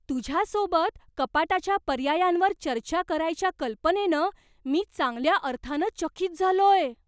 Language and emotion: Marathi, surprised